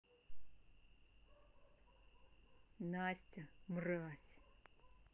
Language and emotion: Russian, neutral